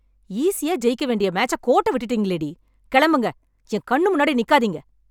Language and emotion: Tamil, angry